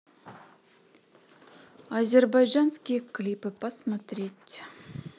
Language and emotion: Russian, neutral